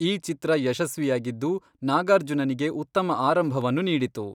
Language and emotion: Kannada, neutral